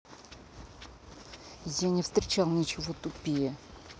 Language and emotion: Russian, angry